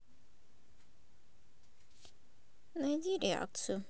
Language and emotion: Russian, neutral